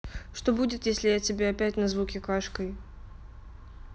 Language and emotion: Russian, neutral